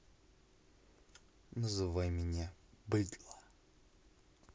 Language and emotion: Russian, neutral